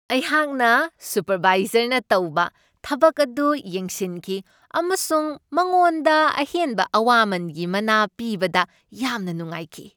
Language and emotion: Manipuri, happy